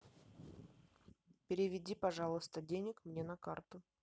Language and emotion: Russian, neutral